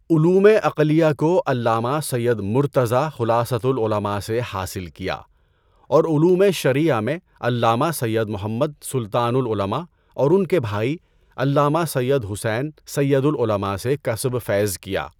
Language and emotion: Urdu, neutral